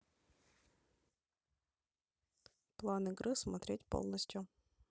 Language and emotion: Russian, neutral